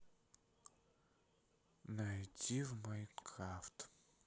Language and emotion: Russian, neutral